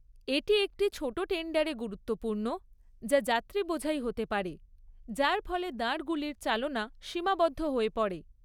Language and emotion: Bengali, neutral